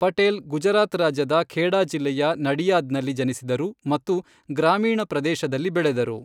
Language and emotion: Kannada, neutral